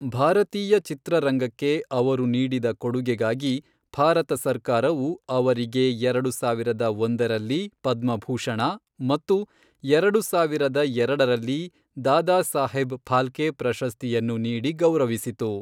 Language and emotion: Kannada, neutral